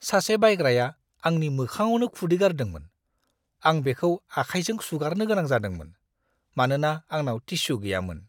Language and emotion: Bodo, disgusted